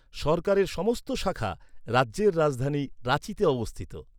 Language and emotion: Bengali, neutral